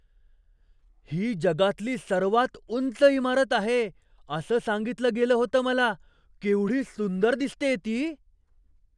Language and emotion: Marathi, surprised